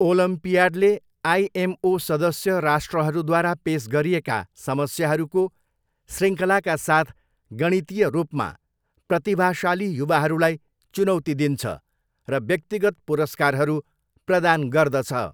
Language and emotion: Nepali, neutral